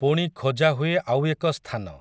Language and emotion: Odia, neutral